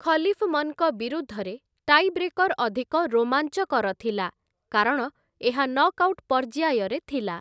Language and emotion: Odia, neutral